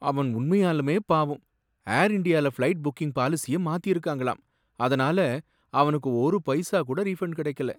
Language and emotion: Tamil, sad